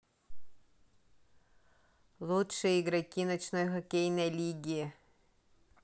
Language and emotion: Russian, neutral